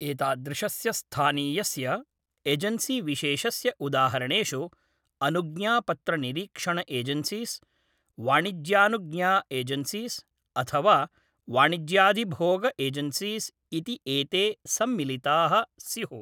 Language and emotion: Sanskrit, neutral